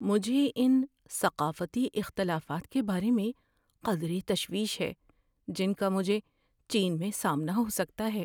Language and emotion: Urdu, fearful